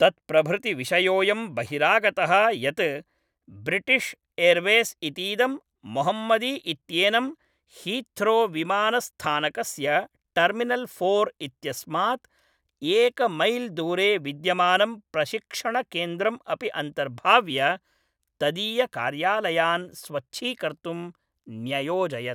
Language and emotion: Sanskrit, neutral